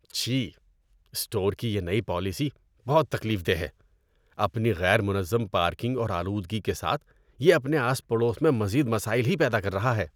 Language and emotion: Urdu, disgusted